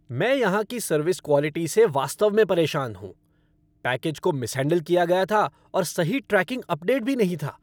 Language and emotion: Hindi, angry